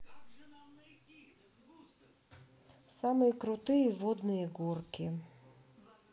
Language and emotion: Russian, neutral